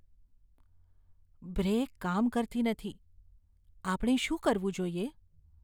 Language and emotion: Gujarati, fearful